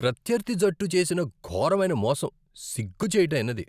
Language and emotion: Telugu, disgusted